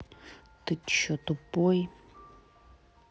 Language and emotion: Russian, angry